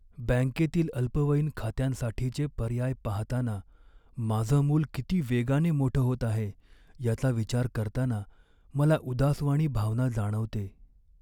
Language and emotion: Marathi, sad